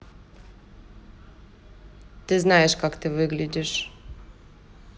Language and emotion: Russian, neutral